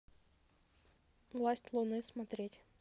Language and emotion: Russian, neutral